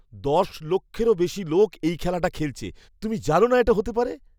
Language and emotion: Bengali, surprised